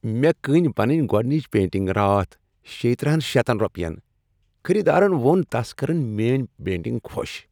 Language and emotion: Kashmiri, happy